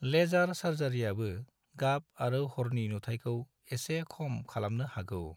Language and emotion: Bodo, neutral